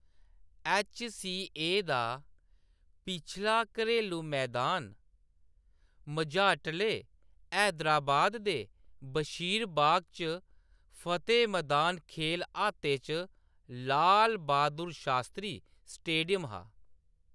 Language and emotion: Dogri, neutral